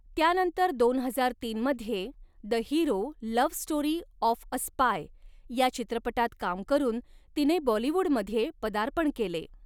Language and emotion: Marathi, neutral